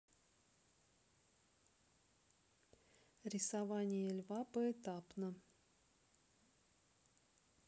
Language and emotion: Russian, neutral